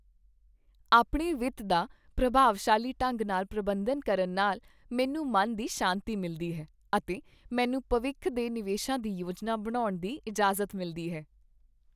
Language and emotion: Punjabi, happy